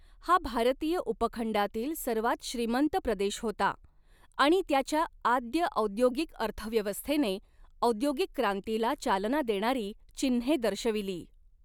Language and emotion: Marathi, neutral